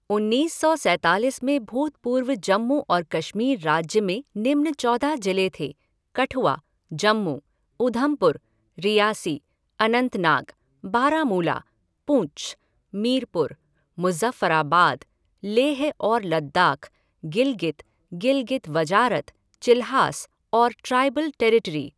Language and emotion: Hindi, neutral